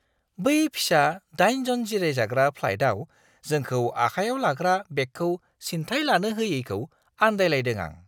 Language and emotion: Bodo, surprised